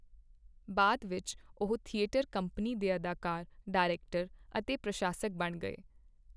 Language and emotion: Punjabi, neutral